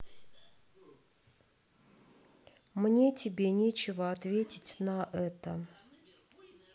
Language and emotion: Russian, neutral